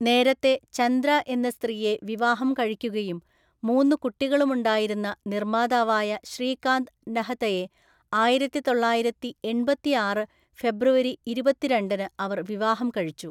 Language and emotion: Malayalam, neutral